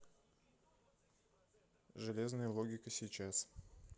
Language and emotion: Russian, neutral